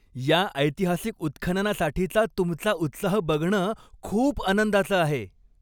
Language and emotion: Marathi, happy